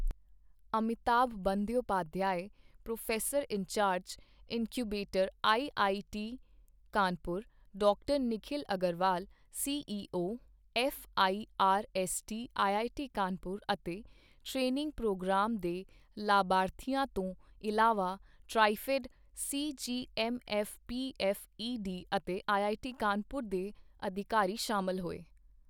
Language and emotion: Punjabi, neutral